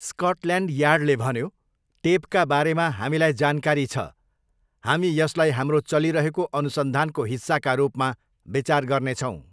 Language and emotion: Nepali, neutral